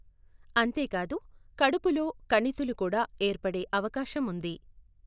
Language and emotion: Telugu, neutral